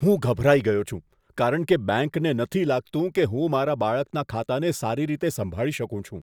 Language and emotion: Gujarati, disgusted